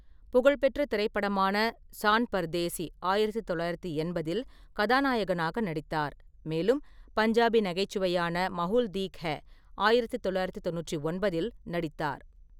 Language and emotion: Tamil, neutral